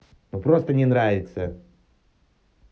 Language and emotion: Russian, angry